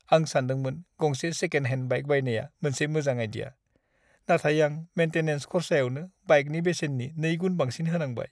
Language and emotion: Bodo, sad